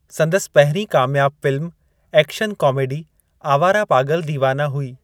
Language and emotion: Sindhi, neutral